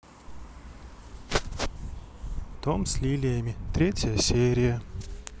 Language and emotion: Russian, neutral